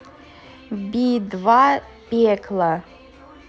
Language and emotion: Russian, neutral